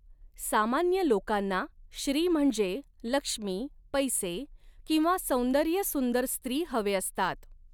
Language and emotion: Marathi, neutral